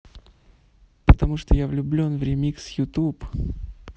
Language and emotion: Russian, neutral